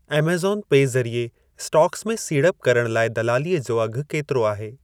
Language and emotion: Sindhi, neutral